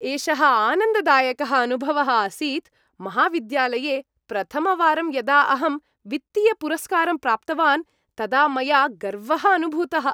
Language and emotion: Sanskrit, happy